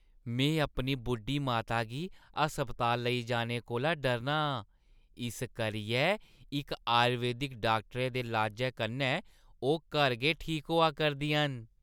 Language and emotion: Dogri, happy